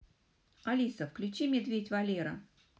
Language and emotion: Russian, positive